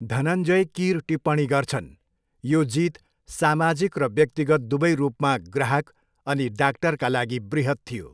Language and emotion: Nepali, neutral